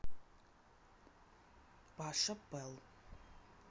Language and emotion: Russian, neutral